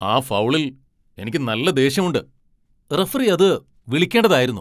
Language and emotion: Malayalam, angry